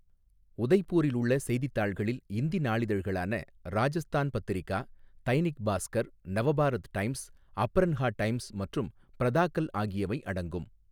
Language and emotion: Tamil, neutral